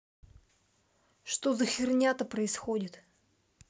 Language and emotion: Russian, angry